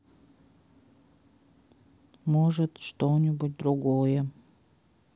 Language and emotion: Russian, sad